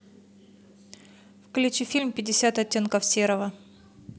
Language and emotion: Russian, neutral